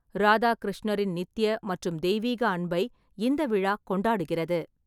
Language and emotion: Tamil, neutral